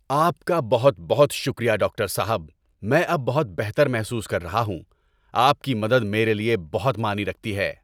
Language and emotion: Urdu, happy